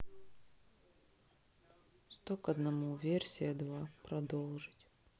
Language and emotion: Russian, neutral